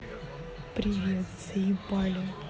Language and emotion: Russian, angry